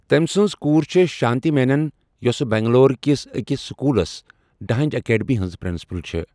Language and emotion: Kashmiri, neutral